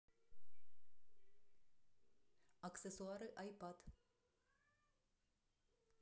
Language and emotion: Russian, neutral